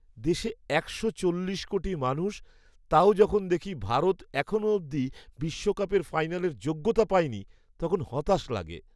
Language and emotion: Bengali, sad